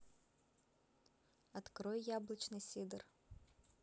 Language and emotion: Russian, neutral